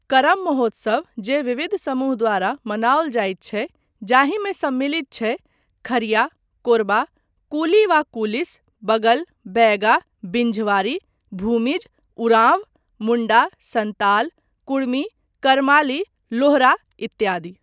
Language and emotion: Maithili, neutral